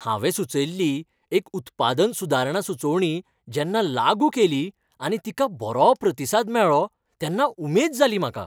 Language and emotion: Goan Konkani, happy